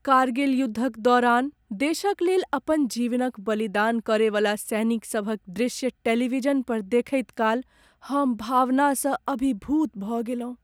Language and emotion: Maithili, sad